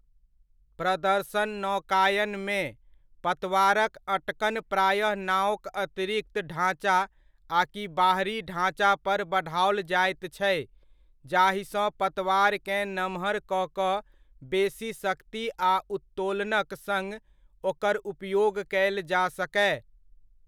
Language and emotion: Maithili, neutral